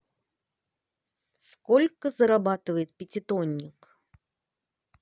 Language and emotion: Russian, positive